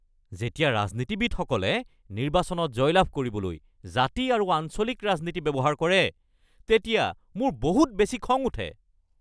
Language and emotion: Assamese, angry